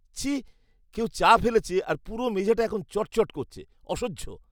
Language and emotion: Bengali, disgusted